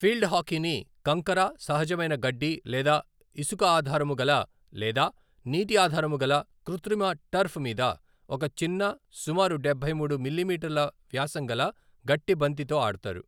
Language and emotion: Telugu, neutral